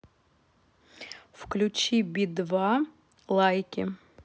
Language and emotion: Russian, neutral